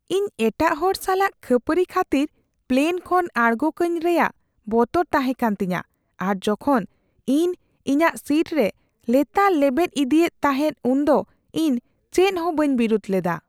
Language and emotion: Santali, fearful